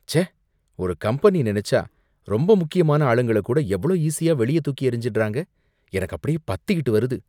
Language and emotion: Tamil, disgusted